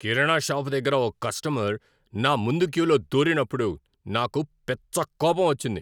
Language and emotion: Telugu, angry